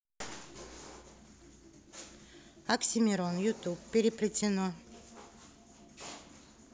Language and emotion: Russian, neutral